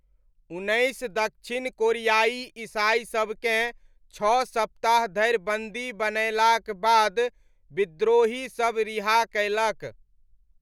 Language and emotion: Maithili, neutral